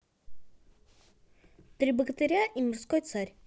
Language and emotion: Russian, neutral